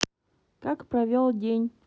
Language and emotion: Russian, neutral